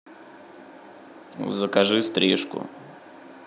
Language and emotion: Russian, neutral